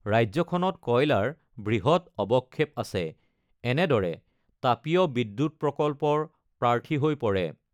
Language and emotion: Assamese, neutral